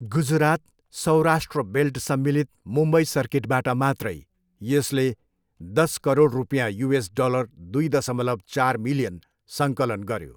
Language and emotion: Nepali, neutral